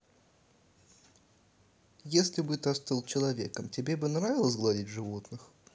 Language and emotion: Russian, neutral